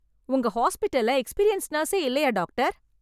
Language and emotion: Tamil, angry